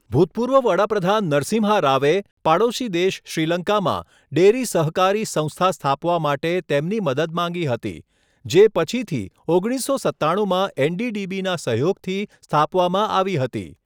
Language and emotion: Gujarati, neutral